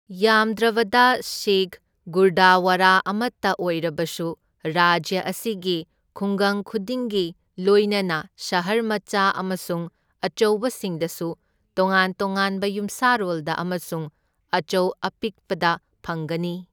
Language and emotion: Manipuri, neutral